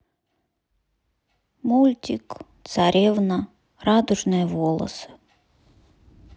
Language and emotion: Russian, sad